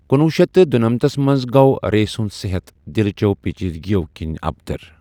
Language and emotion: Kashmiri, neutral